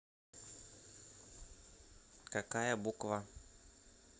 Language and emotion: Russian, neutral